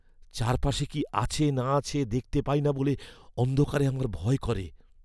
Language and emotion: Bengali, fearful